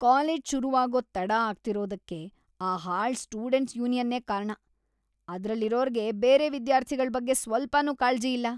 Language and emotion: Kannada, disgusted